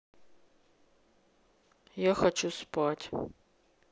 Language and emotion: Russian, sad